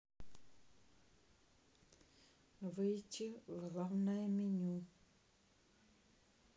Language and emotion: Russian, neutral